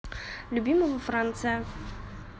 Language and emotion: Russian, neutral